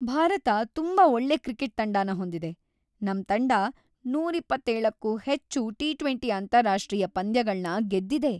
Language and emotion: Kannada, happy